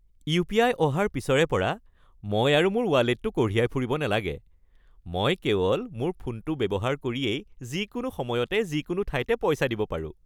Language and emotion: Assamese, happy